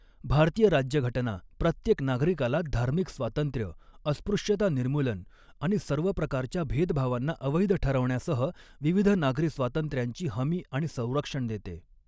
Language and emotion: Marathi, neutral